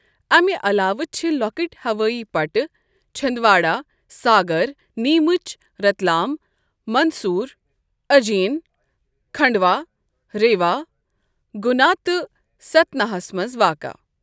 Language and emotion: Kashmiri, neutral